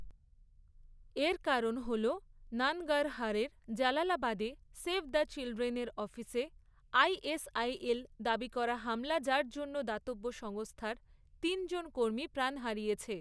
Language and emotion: Bengali, neutral